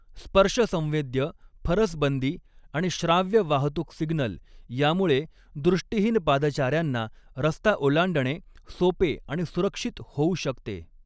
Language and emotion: Marathi, neutral